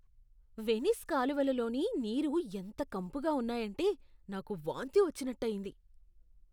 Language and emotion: Telugu, disgusted